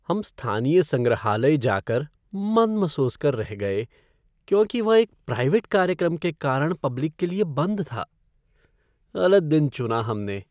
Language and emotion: Hindi, sad